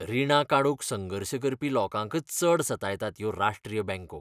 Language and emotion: Goan Konkani, disgusted